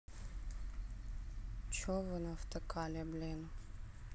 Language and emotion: Russian, neutral